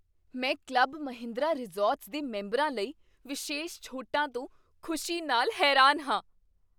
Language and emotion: Punjabi, surprised